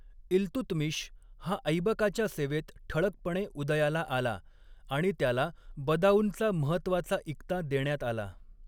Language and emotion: Marathi, neutral